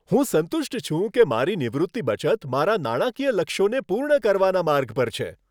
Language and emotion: Gujarati, happy